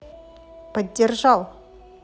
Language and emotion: Russian, positive